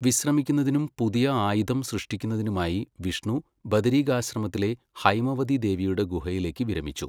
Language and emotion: Malayalam, neutral